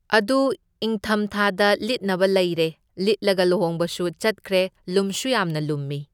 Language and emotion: Manipuri, neutral